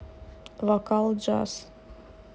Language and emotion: Russian, neutral